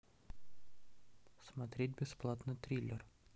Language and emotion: Russian, neutral